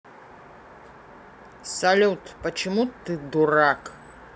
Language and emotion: Russian, neutral